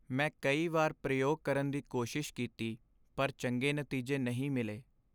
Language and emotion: Punjabi, sad